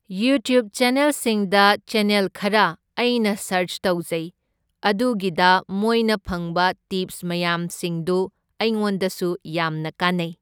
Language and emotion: Manipuri, neutral